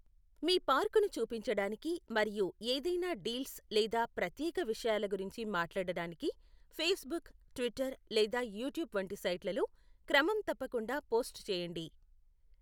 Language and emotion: Telugu, neutral